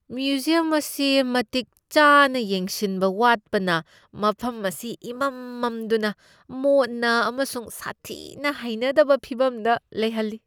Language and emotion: Manipuri, disgusted